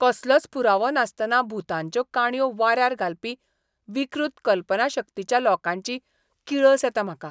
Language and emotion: Goan Konkani, disgusted